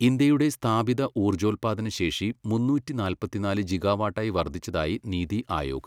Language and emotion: Malayalam, neutral